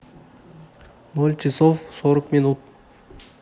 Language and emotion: Russian, neutral